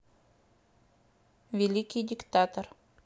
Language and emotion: Russian, neutral